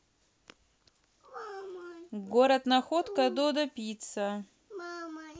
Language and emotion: Russian, neutral